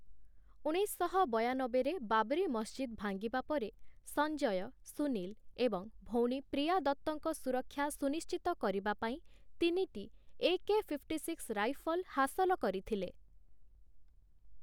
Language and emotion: Odia, neutral